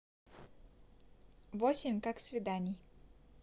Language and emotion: Russian, neutral